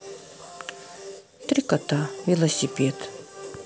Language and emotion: Russian, sad